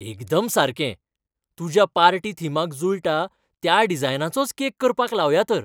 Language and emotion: Goan Konkani, happy